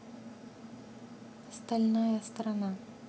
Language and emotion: Russian, neutral